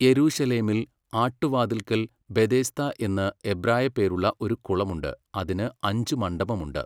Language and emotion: Malayalam, neutral